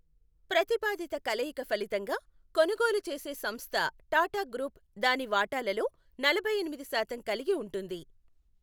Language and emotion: Telugu, neutral